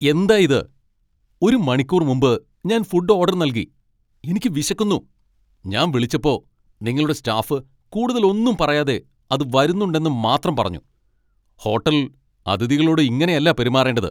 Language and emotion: Malayalam, angry